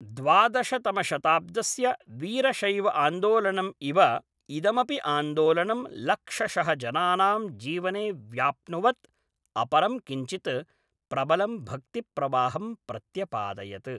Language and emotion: Sanskrit, neutral